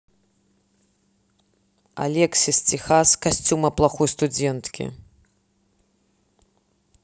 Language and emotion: Russian, neutral